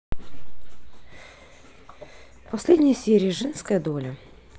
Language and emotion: Russian, neutral